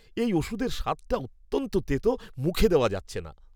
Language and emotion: Bengali, disgusted